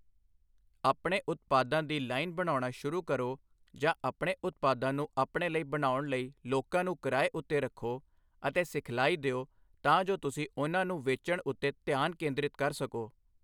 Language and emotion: Punjabi, neutral